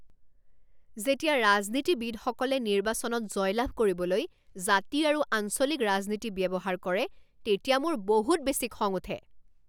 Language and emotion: Assamese, angry